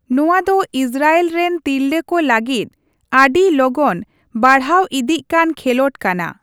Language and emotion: Santali, neutral